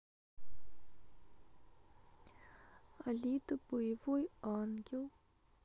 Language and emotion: Russian, sad